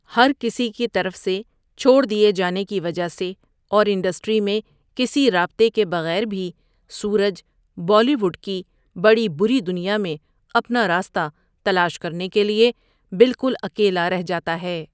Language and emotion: Urdu, neutral